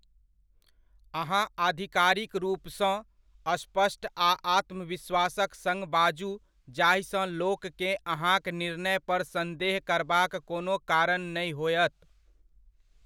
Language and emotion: Maithili, neutral